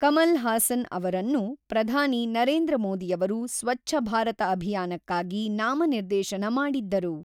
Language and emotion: Kannada, neutral